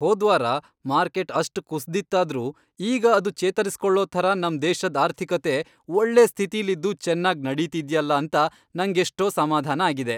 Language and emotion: Kannada, happy